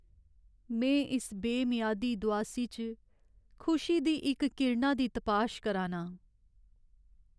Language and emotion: Dogri, sad